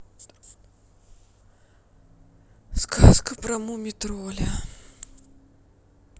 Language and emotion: Russian, sad